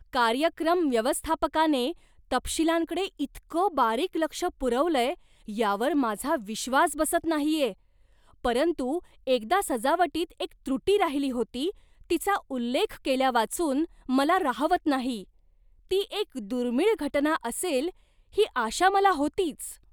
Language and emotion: Marathi, surprised